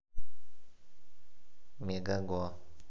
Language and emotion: Russian, neutral